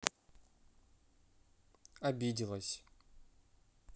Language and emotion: Russian, neutral